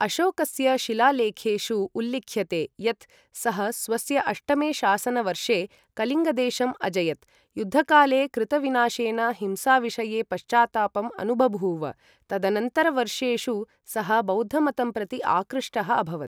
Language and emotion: Sanskrit, neutral